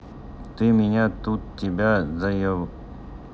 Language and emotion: Russian, neutral